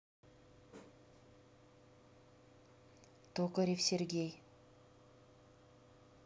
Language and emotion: Russian, neutral